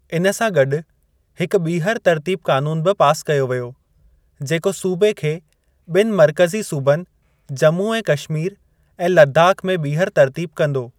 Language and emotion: Sindhi, neutral